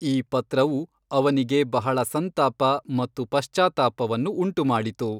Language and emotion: Kannada, neutral